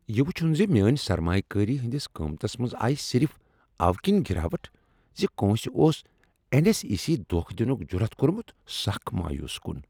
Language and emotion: Kashmiri, angry